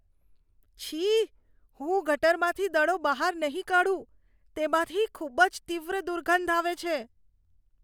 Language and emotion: Gujarati, disgusted